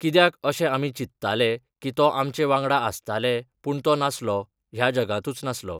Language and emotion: Goan Konkani, neutral